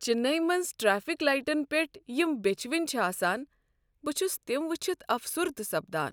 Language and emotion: Kashmiri, sad